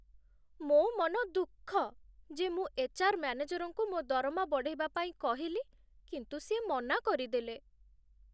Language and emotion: Odia, sad